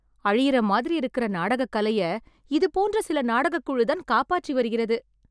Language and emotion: Tamil, happy